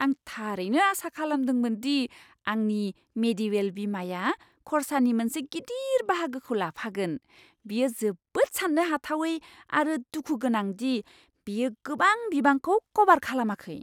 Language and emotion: Bodo, surprised